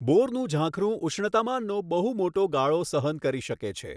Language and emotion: Gujarati, neutral